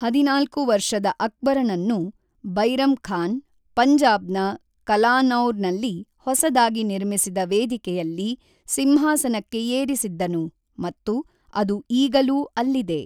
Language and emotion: Kannada, neutral